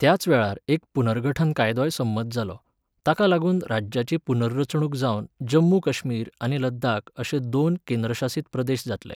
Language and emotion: Goan Konkani, neutral